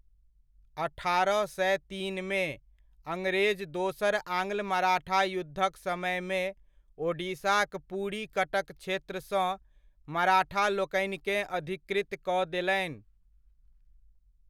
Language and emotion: Maithili, neutral